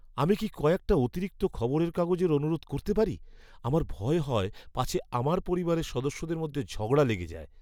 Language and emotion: Bengali, fearful